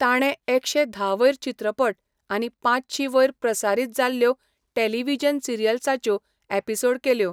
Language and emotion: Goan Konkani, neutral